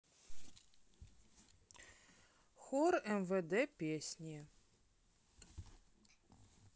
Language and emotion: Russian, neutral